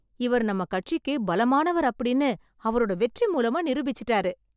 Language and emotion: Tamil, happy